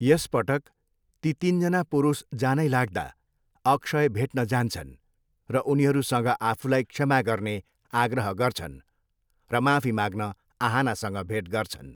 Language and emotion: Nepali, neutral